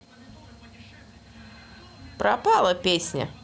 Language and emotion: Russian, neutral